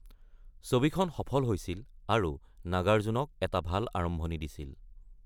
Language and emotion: Assamese, neutral